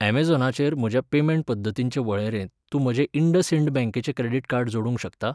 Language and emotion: Goan Konkani, neutral